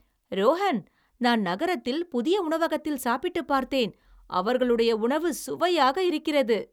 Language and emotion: Tamil, happy